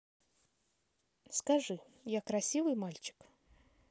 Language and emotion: Russian, neutral